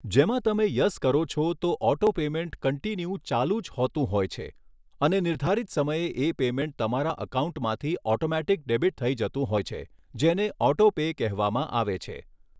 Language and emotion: Gujarati, neutral